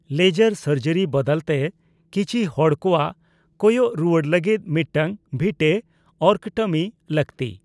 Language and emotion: Santali, neutral